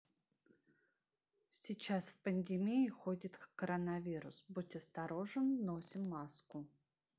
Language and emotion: Russian, neutral